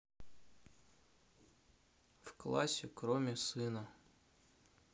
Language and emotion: Russian, neutral